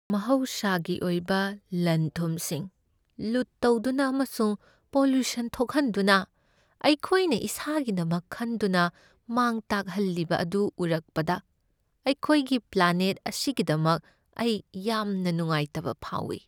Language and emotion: Manipuri, sad